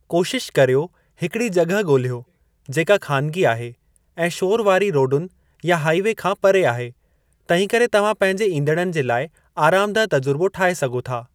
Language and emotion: Sindhi, neutral